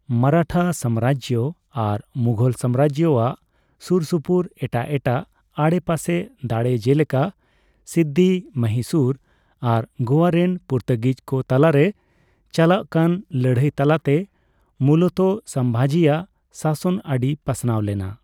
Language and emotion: Santali, neutral